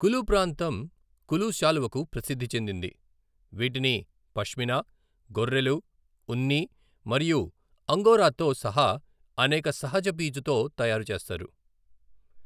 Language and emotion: Telugu, neutral